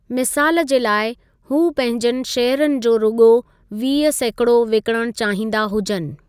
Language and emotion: Sindhi, neutral